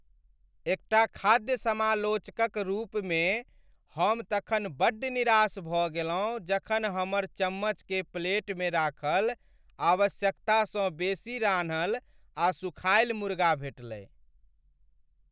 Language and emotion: Maithili, sad